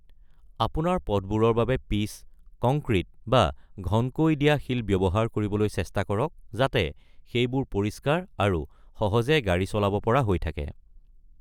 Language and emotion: Assamese, neutral